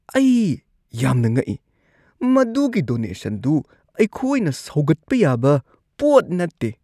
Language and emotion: Manipuri, disgusted